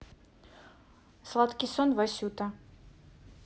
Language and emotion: Russian, neutral